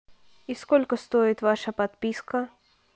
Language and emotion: Russian, neutral